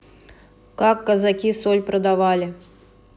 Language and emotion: Russian, neutral